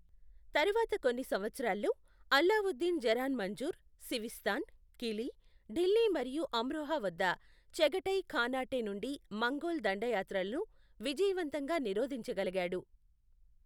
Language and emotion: Telugu, neutral